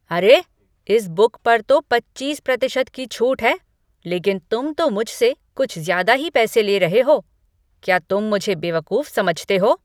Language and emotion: Hindi, angry